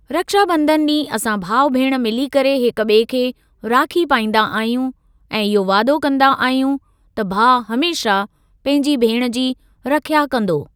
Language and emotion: Sindhi, neutral